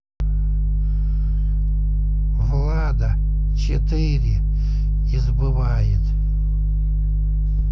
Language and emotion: Russian, neutral